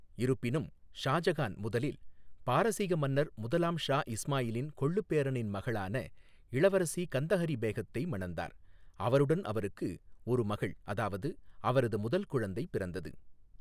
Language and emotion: Tamil, neutral